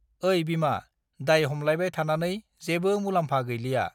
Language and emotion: Bodo, neutral